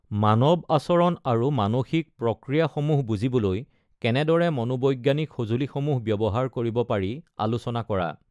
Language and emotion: Assamese, neutral